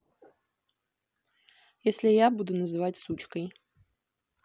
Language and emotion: Russian, neutral